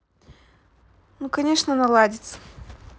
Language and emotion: Russian, positive